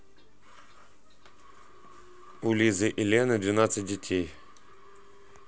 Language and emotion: Russian, neutral